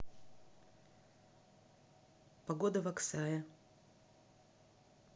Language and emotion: Russian, neutral